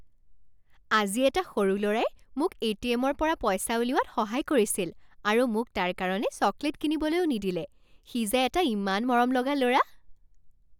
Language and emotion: Assamese, happy